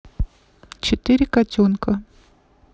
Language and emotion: Russian, neutral